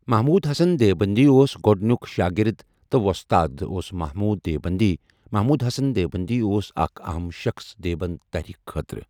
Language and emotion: Kashmiri, neutral